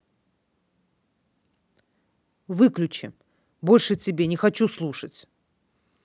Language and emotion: Russian, angry